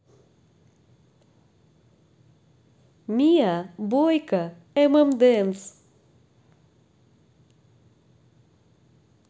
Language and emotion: Russian, positive